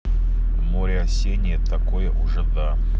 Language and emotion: Russian, neutral